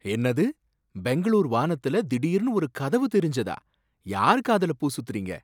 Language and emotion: Tamil, surprised